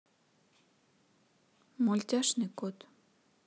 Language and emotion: Russian, neutral